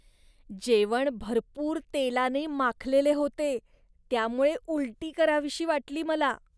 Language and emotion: Marathi, disgusted